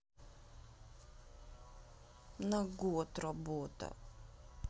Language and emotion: Russian, sad